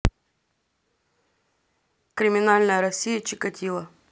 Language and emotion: Russian, neutral